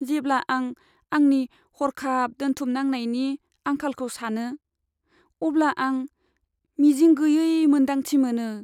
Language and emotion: Bodo, sad